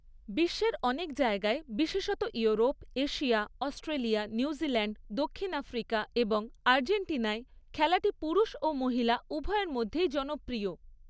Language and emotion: Bengali, neutral